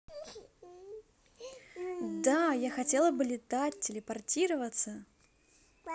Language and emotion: Russian, positive